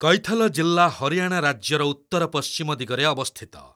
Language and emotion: Odia, neutral